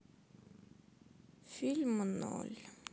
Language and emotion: Russian, sad